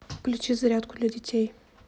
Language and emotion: Russian, neutral